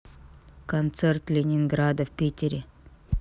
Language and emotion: Russian, neutral